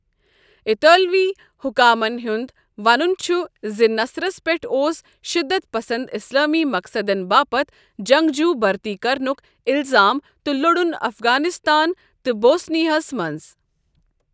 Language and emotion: Kashmiri, neutral